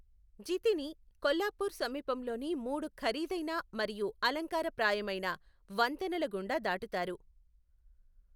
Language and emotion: Telugu, neutral